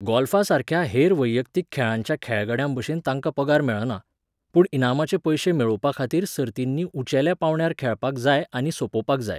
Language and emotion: Goan Konkani, neutral